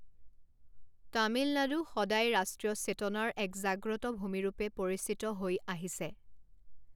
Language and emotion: Assamese, neutral